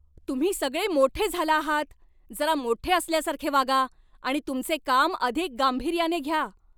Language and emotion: Marathi, angry